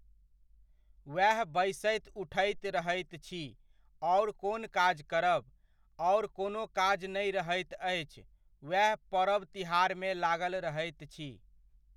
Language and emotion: Maithili, neutral